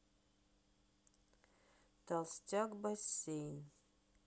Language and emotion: Russian, neutral